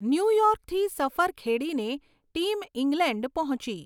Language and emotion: Gujarati, neutral